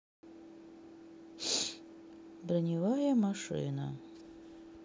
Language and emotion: Russian, sad